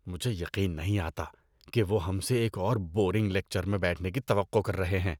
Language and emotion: Urdu, disgusted